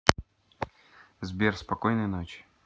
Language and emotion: Russian, neutral